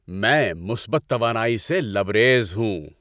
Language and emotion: Urdu, happy